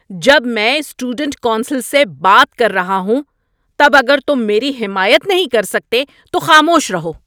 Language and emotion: Urdu, angry